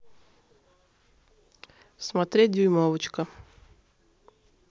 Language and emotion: Russian, neutral